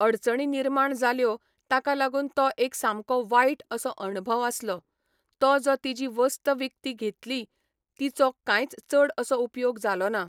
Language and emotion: Goan Konkani, neutral